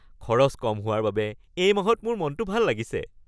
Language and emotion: Assamese, happy